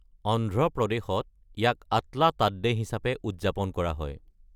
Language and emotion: Assamese, neutral